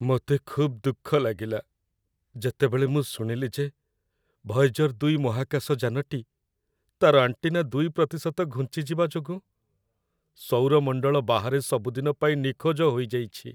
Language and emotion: Odia, sad